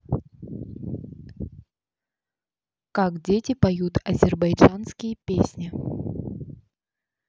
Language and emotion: Russian, neutral